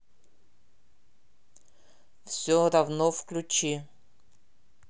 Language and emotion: Russian, neutral